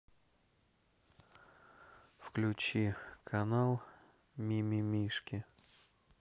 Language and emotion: Russian, neutral